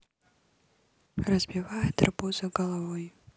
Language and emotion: Russian, neutral